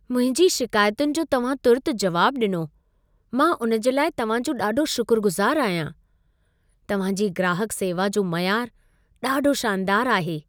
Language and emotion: Sindhi, happy